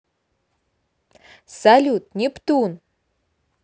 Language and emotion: Russian, positive